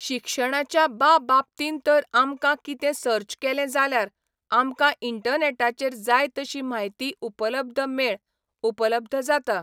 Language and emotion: Goan Konkani, neutral